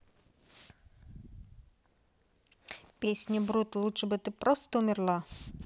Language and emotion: Russian, neutral